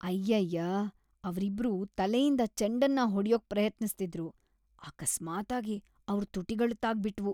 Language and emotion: Kannada, disgusted